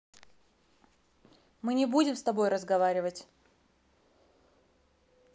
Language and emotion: Russian, angry